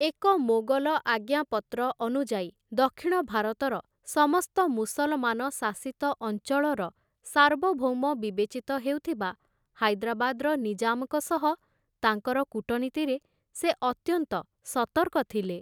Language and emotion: Odia, neutral